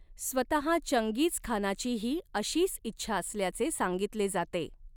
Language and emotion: Marathi, neutral